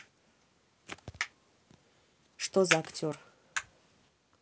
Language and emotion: Russian, neutral